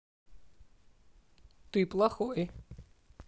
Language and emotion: Russian, neutral